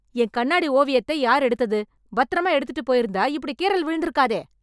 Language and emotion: Tamil, angry